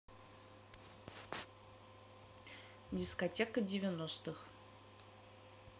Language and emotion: Russian, neutral